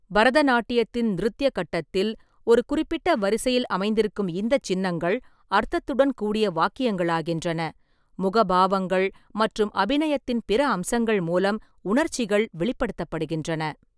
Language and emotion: Tamil, neutral